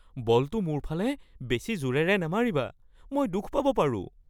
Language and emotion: Assamese, fearful